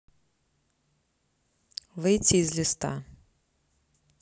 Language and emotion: Russian, neutral